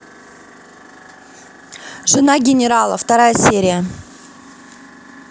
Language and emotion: Russian, neutral